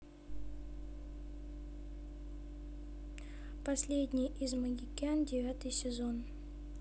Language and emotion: Russian, neutral